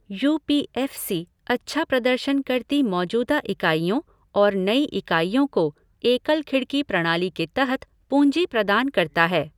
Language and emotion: Hindi, neutral